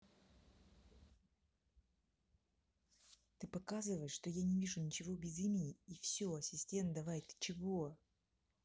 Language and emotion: Russian, angry